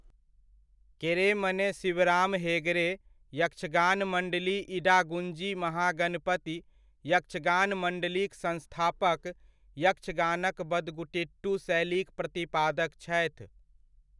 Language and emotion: Maithili, neutral